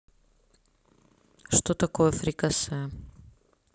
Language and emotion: Russian, neutral